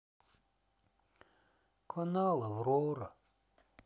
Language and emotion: Russian, sad